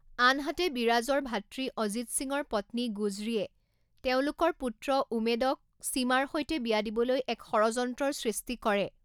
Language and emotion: Assamese, neutral